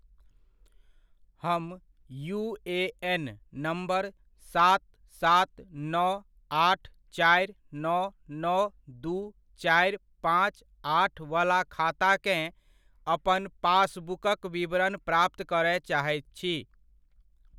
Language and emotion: Maithili, neutral